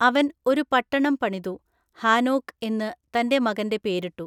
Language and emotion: Malayalam, neutral